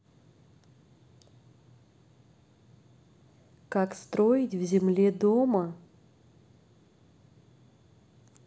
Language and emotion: Russian, neutral